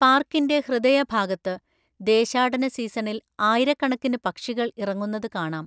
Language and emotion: Malayalam, neutral